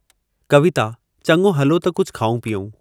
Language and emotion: Sindhi, neutral